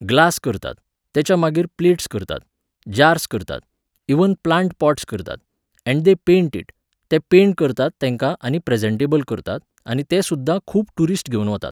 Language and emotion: Goan Konkani, neutral